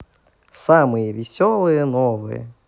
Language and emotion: Russian, positive